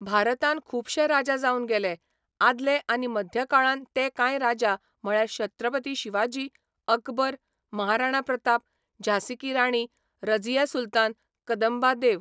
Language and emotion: Goan Konkani, neutral